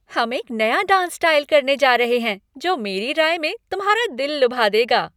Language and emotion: Hindi, happy